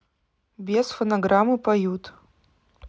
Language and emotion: Russian, neutral